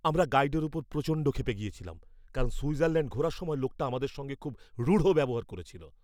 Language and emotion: Bengali, angry